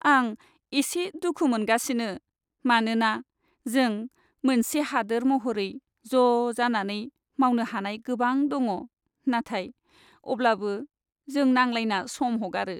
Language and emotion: Bodo, sad